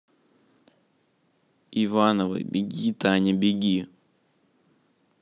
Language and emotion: Russian, neutral